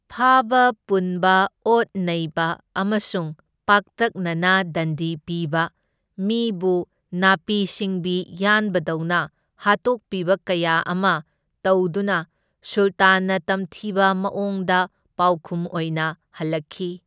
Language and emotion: Manipuri, neutral